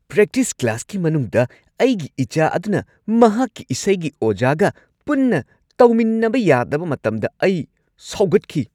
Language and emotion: Manipuri, angry